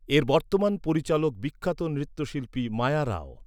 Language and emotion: Bengali, neutral